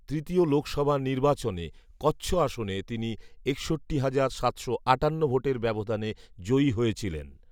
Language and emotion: Bengali, neutral